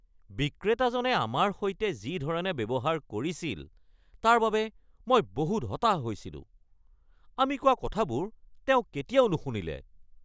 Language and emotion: Assamese, angry